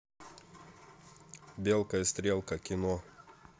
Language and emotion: Russian, neutral